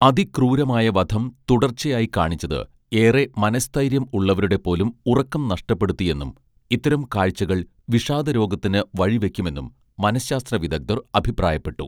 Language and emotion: Malayalam, neutral